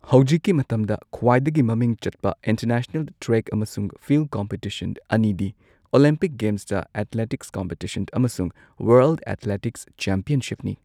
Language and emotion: Manipuri, neutral